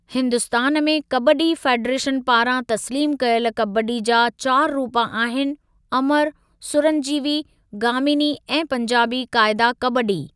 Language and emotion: Sindhi, neutral